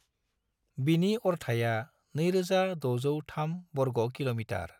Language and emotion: Bodo, neutral